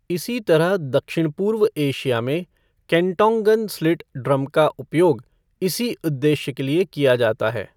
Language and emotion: Hindi, neutral